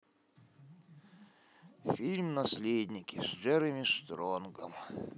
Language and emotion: Russian, sad